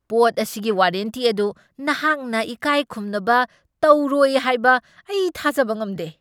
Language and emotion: Manipuri, angry